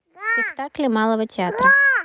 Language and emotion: Russian, neutral